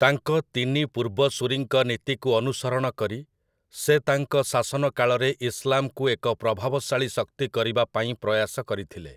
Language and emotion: Odia, neutral